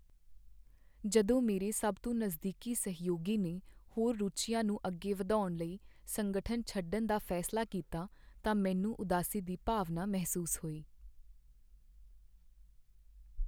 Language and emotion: Punjabi, sad